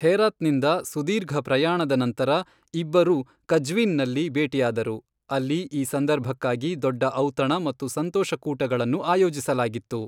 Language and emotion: Kannada, neutral